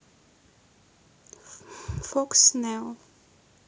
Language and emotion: Russian, neutral